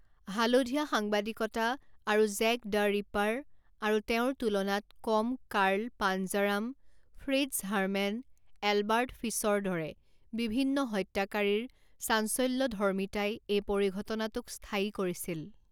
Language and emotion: Assamese, neutral